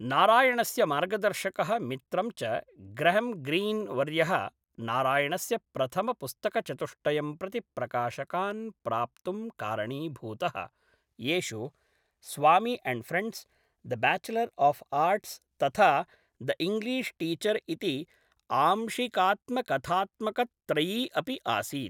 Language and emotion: Sanskrit, neutral